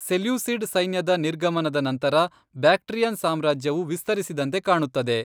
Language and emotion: Kannada, neutral